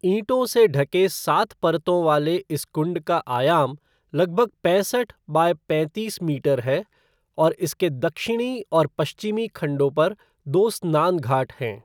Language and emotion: Hindi, neutral